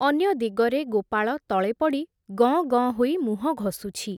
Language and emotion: Odia, neutral